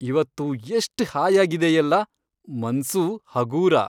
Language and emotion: Kannada, happy